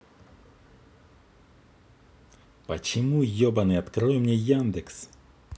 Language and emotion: Russian, angry